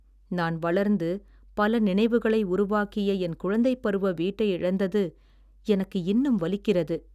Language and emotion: Tamil, sad